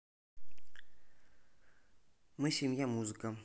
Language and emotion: Russian, neutral